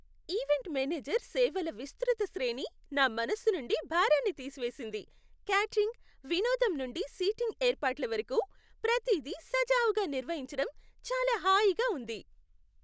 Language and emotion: Telugu, happy